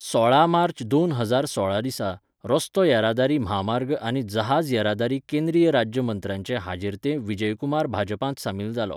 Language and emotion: Goan Konkani, neutral